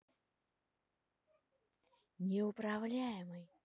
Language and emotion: Russian, neutral